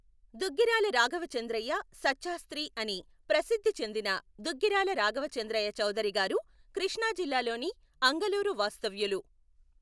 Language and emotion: Telugu, neutral